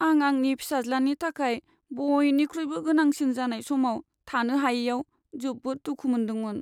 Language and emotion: Bodo, sad